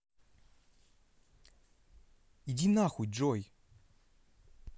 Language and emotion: Russian, angry